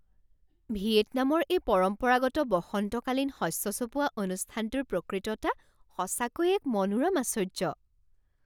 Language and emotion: Assamese, surprised